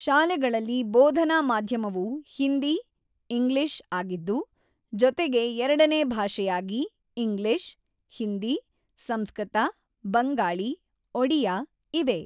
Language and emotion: Kannada, neutral